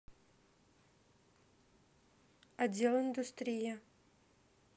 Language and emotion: Russian, neutral